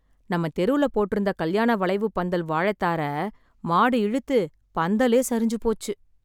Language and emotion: Tamil, sad